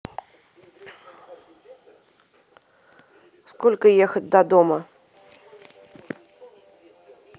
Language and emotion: Russian, neutral